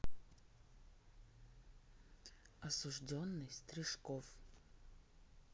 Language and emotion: Russian, neutral